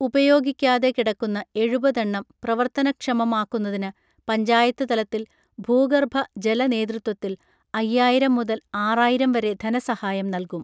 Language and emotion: Malayalam, neutral